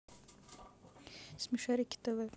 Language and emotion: Russian, neutral